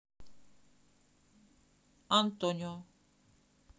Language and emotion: Russian, neutral